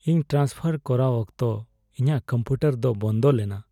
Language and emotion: Santali, sad